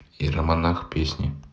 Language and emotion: Russian, neutral